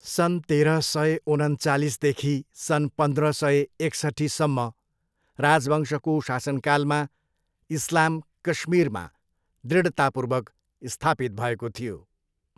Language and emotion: Nepali, neutral